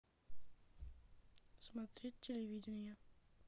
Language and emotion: Russian, neutral